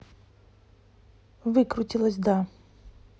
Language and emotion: Russian, neutral